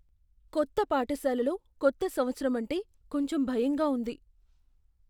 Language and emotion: Telugu, fearful